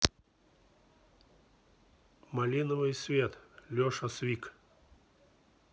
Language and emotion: Russian, neutral